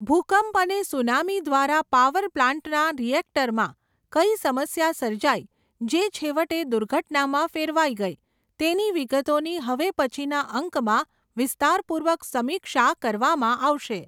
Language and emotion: Gujarati, neutral